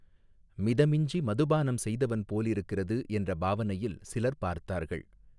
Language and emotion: Tamil, neutral